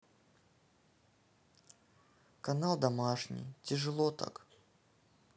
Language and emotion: Russian, sad